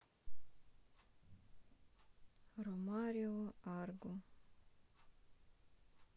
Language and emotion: Russian, sad